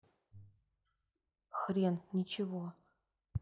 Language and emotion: Russian, neutral